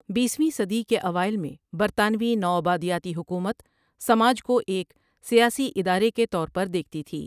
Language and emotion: Urdu, neutral